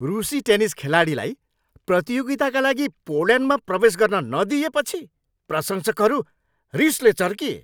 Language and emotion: Nepali, angry